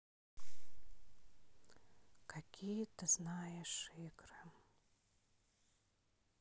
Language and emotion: Russian, sad